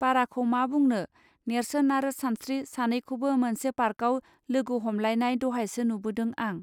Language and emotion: Bodo, neutral